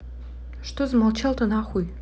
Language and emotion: Russian, neutral